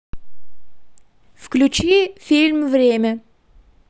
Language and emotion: Russian, neutral